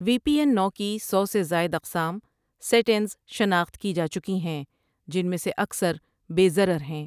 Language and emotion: Urdu, neutral